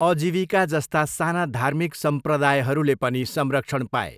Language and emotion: Nepali, neutral